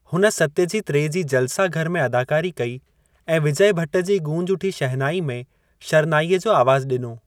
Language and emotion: Sindhi, neutral